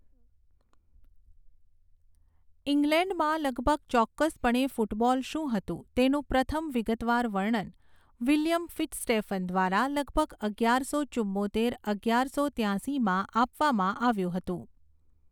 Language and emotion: Gujarati, neutral